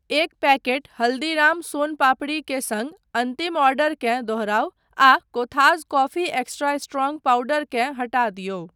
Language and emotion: Maithili, neutral